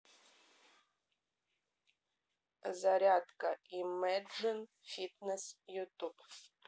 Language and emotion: Russian, neutral